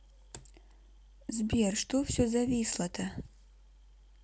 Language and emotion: Russian, neutral